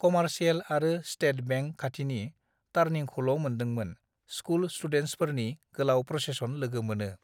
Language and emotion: Bodo, neutral